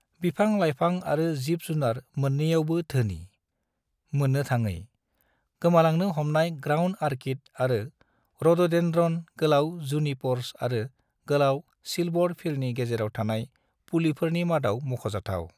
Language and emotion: Bodo, neutral